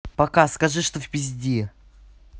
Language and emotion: Russian, angry